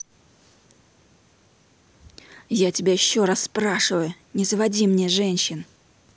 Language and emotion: Russian, angry